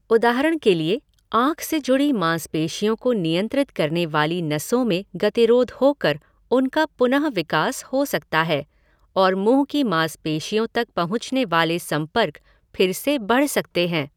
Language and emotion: Hindi, neutral